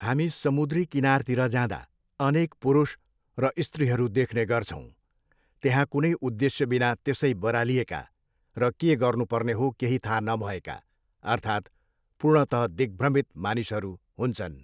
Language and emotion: Nepali, neutral